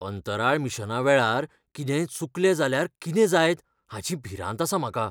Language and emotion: Goan Konkani, fearful